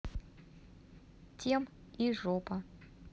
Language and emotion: Russian, neutral